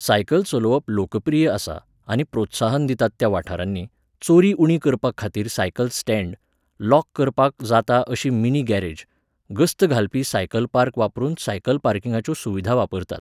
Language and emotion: Goan Konkani, neutral